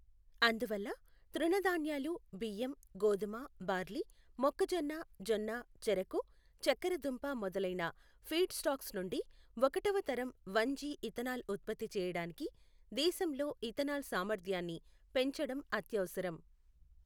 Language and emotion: Telugu, neutral